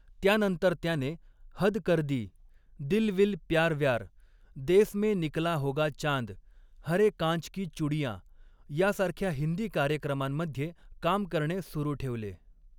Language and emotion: Marathi, neutral